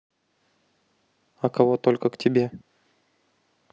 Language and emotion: Russian, neutral